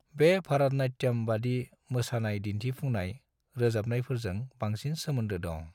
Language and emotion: Bodo, neutral